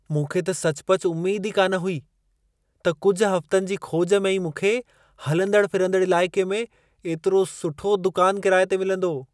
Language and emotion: Sindhi, surprised